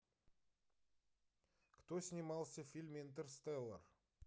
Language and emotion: Russian, neutral